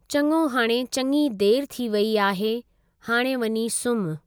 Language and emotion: Sindhi, neutral